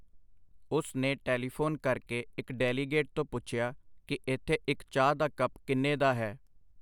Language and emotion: Punjabi, neutral